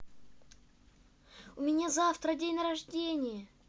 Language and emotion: Russian, positive